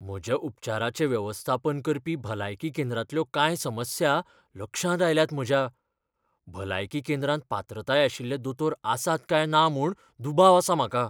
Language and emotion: Goan Konkani, fearful